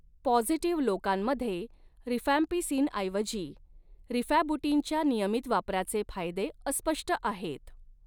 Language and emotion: Marathi, neutral